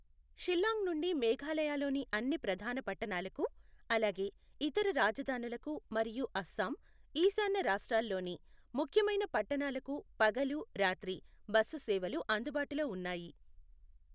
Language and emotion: Telugu, neutral